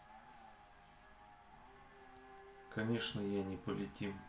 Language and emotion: Russian, neutral